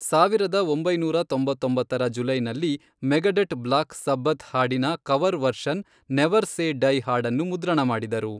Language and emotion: Kannada, neutral